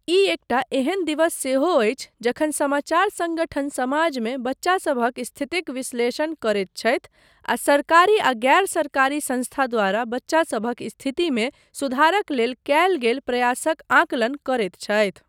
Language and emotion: Maithili, neutral